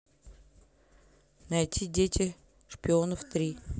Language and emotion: Russian, neutral